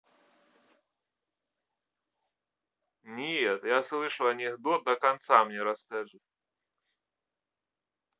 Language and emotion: Russian, neutral